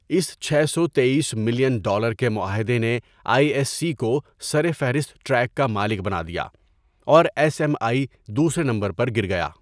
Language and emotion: Urdu, neutral